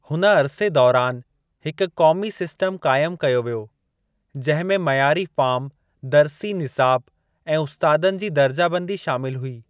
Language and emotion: Sindhi, neutral